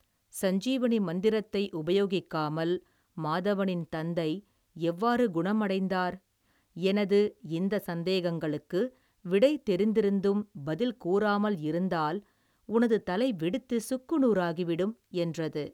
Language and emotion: Tamil, neutral